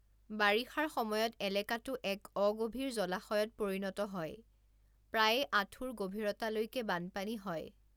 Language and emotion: Assamese, neutral